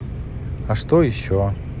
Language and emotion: Russian, neutral